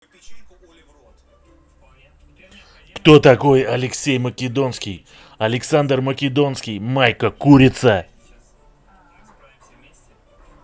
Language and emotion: Russian, angry